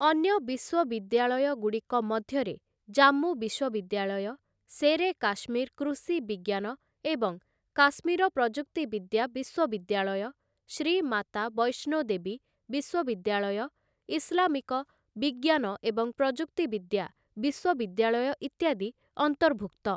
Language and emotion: Odia, neutral